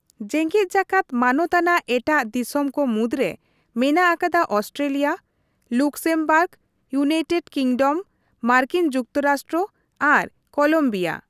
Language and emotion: Santali, neutral